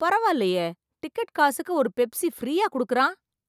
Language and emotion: Tamil, surprised